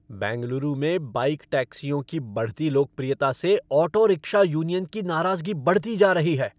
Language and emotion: Hindi, angry